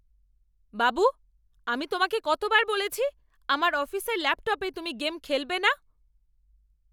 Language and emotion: Bengali, angry